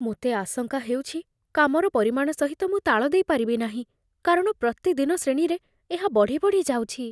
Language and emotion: Odia, fearful